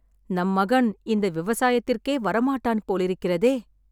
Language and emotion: Tamil, sad